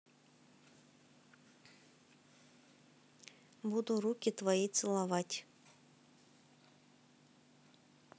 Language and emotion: Russian, neutral